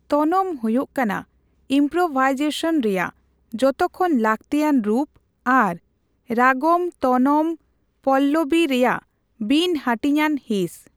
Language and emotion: Santali, neutral